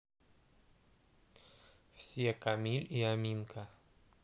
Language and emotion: Russian, neutral